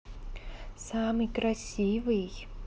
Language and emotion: Russian, positive